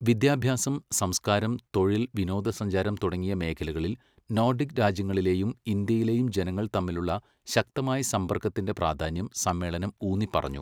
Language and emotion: Malayalam, neutral